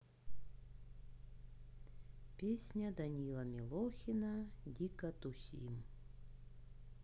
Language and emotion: Russian, neutral